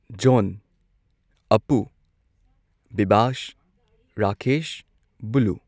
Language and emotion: Manipuri, neutral